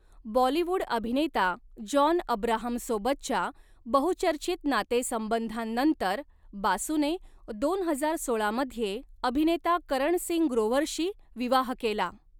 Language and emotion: Marathi, neutral